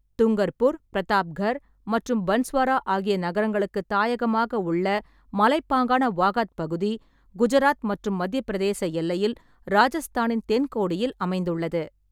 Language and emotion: Tamil, neutral